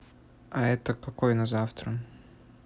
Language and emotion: Russian, neutral